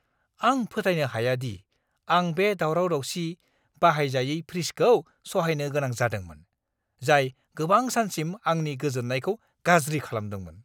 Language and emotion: Bodo, angry